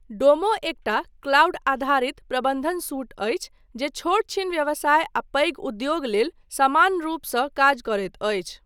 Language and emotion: Maithili, neutral